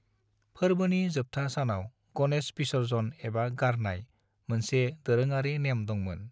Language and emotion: Bodo, neutral